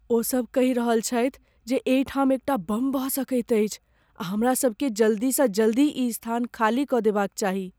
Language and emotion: Maithili, fearful